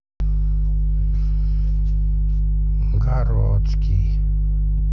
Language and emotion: Russian, neutral